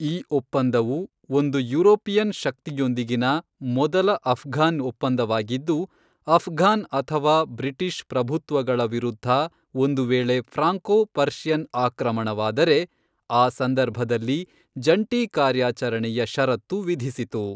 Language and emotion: Kannada, neutral